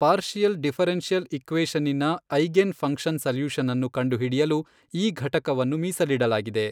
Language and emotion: Kannada, neutral